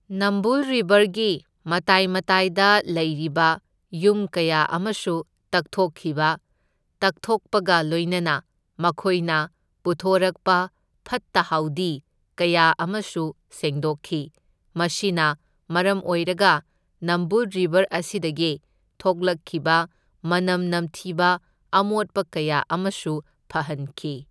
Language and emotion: Manipuri, neutral